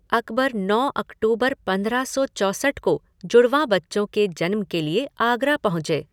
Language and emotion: Hindi, neutral